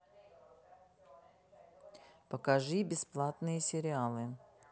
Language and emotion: Russian, neutral